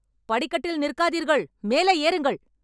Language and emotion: Tamil, angry